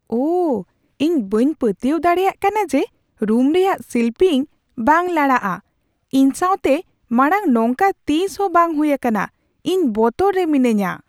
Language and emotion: Santali, surprised